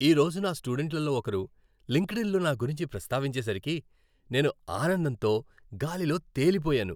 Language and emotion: Telugu, happy